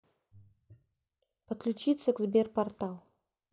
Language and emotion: Russian, neutral